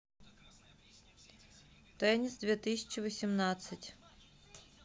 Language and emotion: Russian, neutral